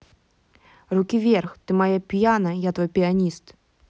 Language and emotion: Russian, angry